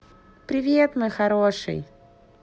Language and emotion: Russian, positive